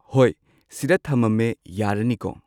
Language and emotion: Manipuri, neutral